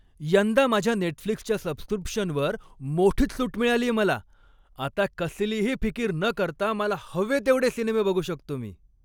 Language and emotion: Marathi, happy